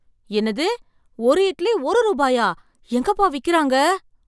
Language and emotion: Tamil, surprised